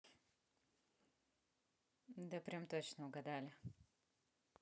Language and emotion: Russian, neutral